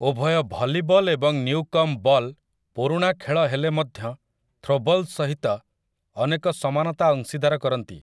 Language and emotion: Odia, neutral